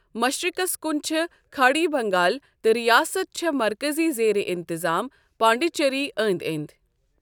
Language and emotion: Kashmiri, neutral